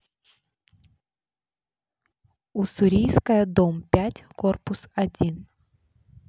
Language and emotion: Russian, neutral